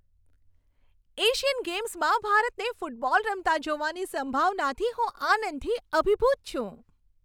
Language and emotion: Gujarati, happy